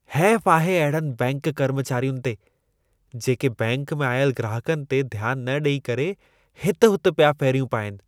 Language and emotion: Sindhi, disgusted